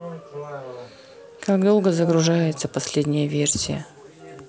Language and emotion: Russian, neutral